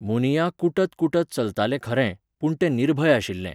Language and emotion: Goan Konkani, neutral